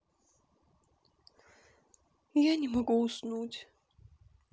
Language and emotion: Russian, sad